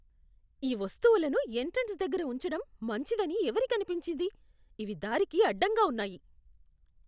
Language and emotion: Telugu, disgusted